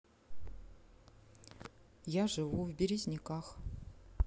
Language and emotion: Russian, neutral